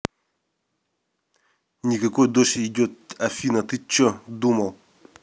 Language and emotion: Russian, angry